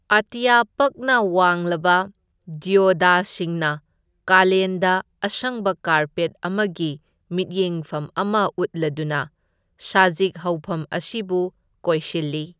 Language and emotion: Manipuri, neutral